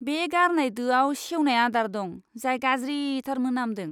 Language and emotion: Bodo, disgusted